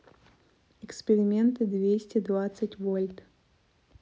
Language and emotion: Russian, neutral